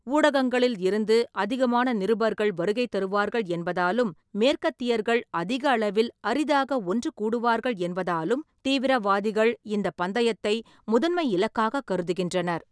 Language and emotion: Tamil, neutral